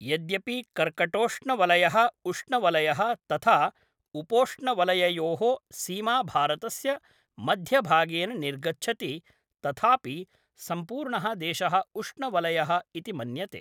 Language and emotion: Sanskrit, neutral